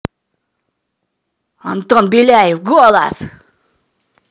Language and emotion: Russian, angry